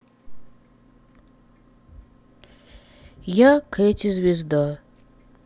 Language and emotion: Russian, sad